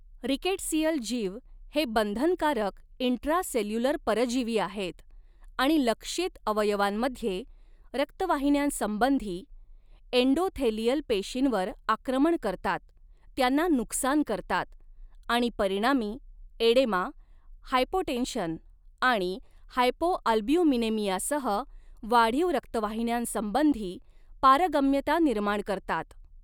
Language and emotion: Marathi, neutral